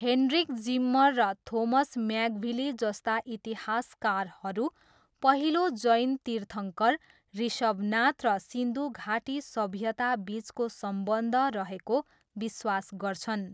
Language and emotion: Nepali, neutral